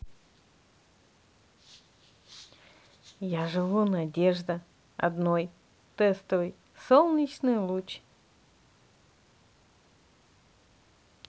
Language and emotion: Russian, positive